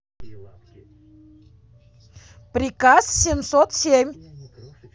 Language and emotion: Russian, angry